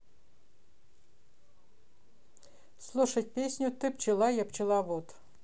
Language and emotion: Russian, neutral